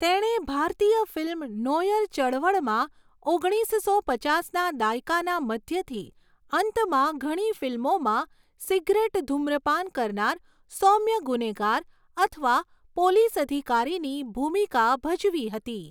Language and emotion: Gujarati, neutral